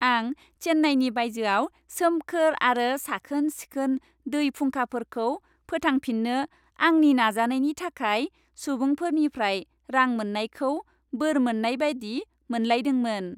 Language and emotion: Bodo, happy